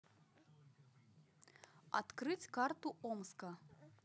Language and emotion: Russian, neutral